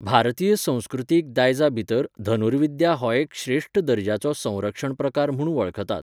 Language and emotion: Goan Konkani, neutral